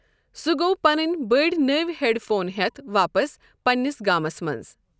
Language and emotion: Kashmiri, neutral